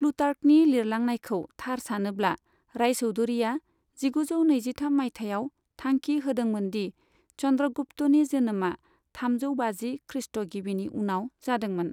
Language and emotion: Bodo, neutral